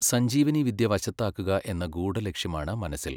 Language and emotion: Malayalam, neutral